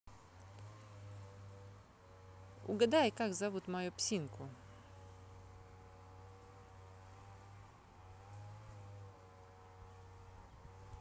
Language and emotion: Russian, neutral